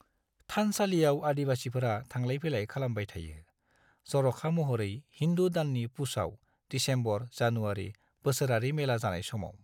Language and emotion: Bodo, neutral